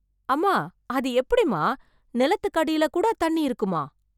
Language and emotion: Tamil, surprised